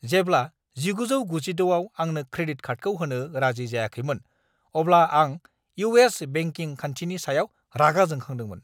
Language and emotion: Bodo, angry